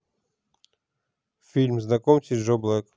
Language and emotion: Russian, neutral